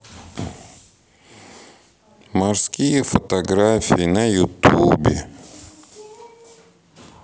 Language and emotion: Russian, sad